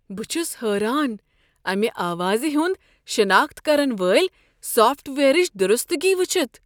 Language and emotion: Kashmiri, surprised